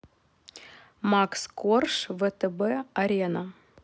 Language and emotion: Russian, neutral